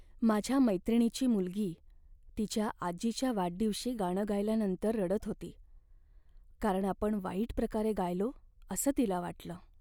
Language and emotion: Marathi, sad